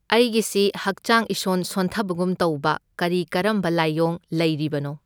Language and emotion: Manipuri, neutral